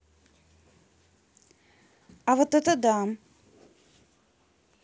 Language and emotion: Russian, neutral